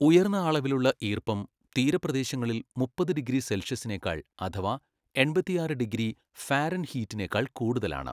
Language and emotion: Malayalam, neutral